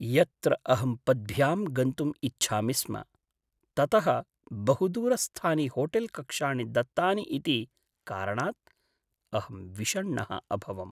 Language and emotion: Sanskrit, sad